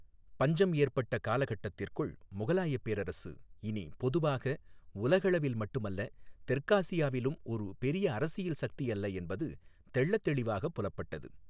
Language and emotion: Tamil, neutral